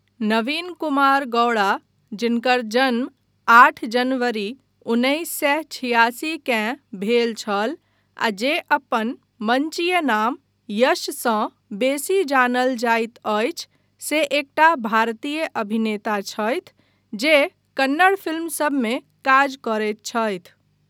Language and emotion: Maithili, neutral